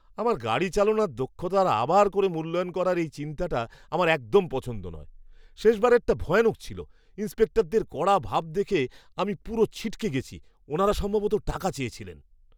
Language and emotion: Bengali, disgusted